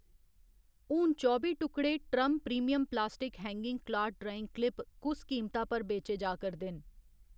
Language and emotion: Dogri, neutral